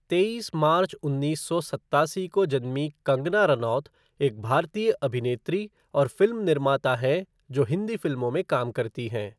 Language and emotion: Hindi, neutral